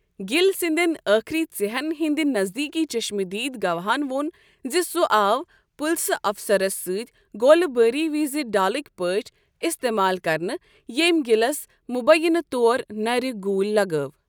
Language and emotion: Kashmiri, neutral